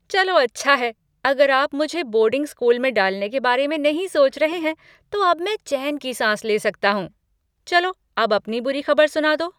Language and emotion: Hindi, happy